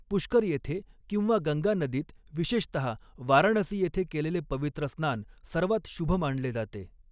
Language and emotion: Marathi, neutral